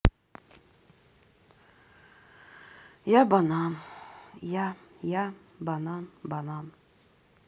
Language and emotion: Russian, sad